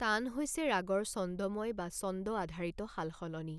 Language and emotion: Assamese, neutral